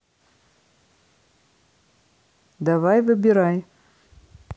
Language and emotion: Russian, neutral